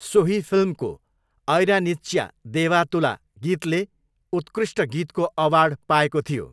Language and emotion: Nepali, neutral